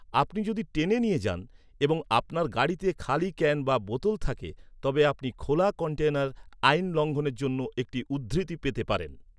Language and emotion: Bengali, neutral